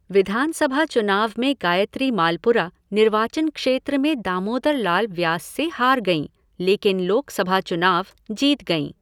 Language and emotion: Hindi, neutral